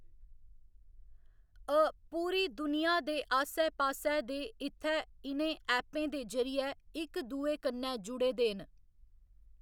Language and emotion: Dogri, neutral